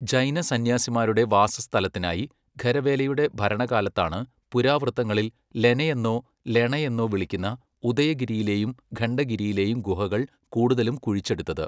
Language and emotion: Malayalam, neutral